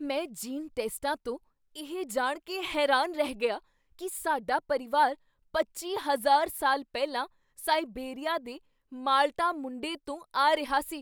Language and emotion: Punjabi, surprised